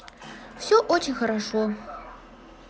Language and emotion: Russian, positive